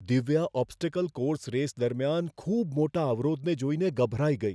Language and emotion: Gujarati, fearful